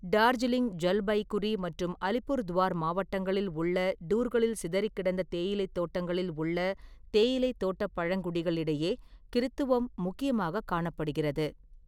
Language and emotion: Tamil, neutral